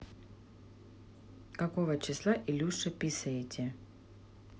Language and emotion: Russian, neutral